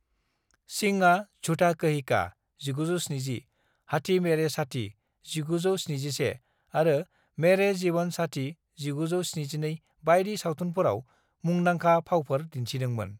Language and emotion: Bodo, neutral